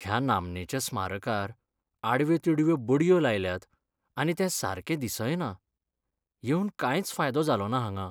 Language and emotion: Goan Konkani, sad